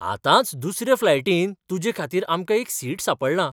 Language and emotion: Goan Konkani, surprised